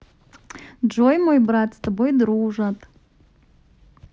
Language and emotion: Russian, positive